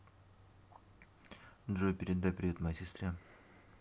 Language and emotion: Russian, neutral